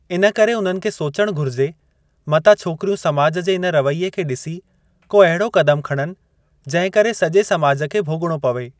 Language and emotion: Sindhi, neutral